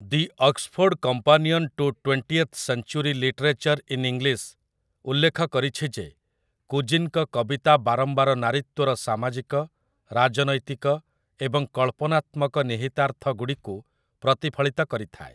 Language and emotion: Odia, neutral